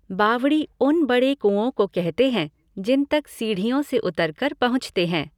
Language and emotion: Hindi, neutral